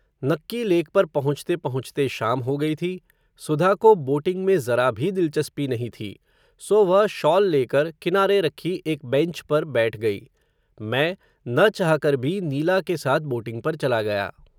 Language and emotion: Hindi, neutral